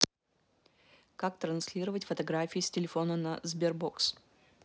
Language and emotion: Russian, neutral